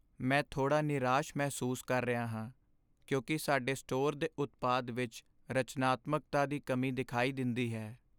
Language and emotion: Punjabi, sad